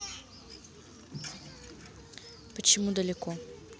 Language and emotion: Russian, neutral